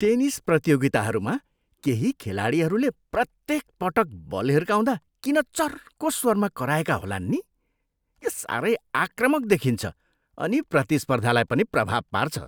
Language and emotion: Nepali, disgusted